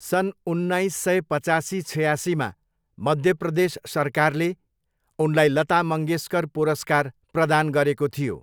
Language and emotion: Nepali, neutral